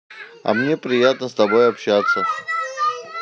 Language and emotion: Russian, positive